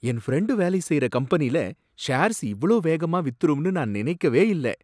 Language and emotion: Tamil, surprised